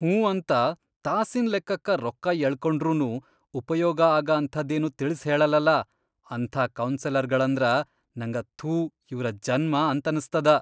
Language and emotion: Kannada, disgusted